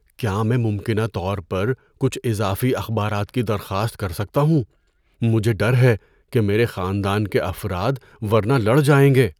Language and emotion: Urdu, fearful